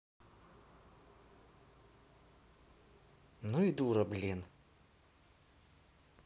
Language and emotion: Russian, angry